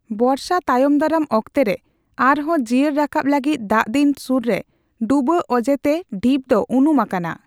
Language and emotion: Santali, neutral